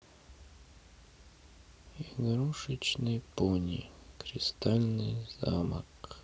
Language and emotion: Russian, sad